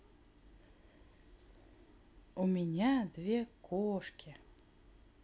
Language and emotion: Russian, positive